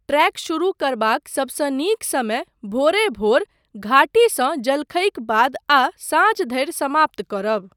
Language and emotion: Maithili, neutral